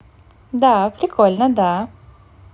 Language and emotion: Russian, positive